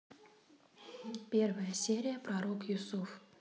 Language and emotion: Russian, neutral